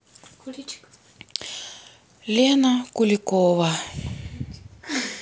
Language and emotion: Russian, sad